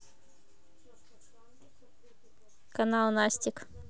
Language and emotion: Russian, neutral